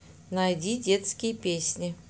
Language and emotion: Russian, neutral